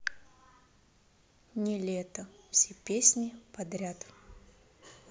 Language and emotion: Russian, neutral